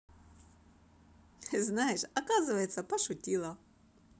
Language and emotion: Russian, positive